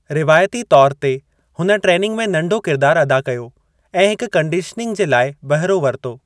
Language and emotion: Sindhi, neutral